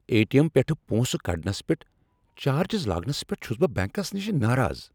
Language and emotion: Kashmiri, angry